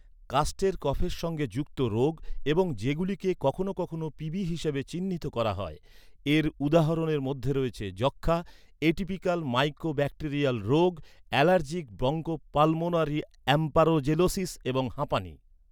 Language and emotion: Bengali, neutral